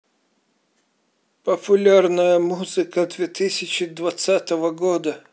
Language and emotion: Russian, neutral